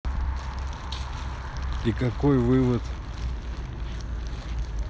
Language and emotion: Russian, neutral